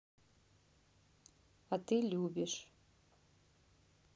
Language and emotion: Russian, neutral